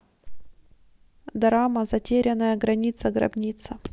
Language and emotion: Russian, neutral